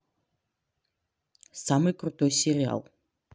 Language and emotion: Russian, neutral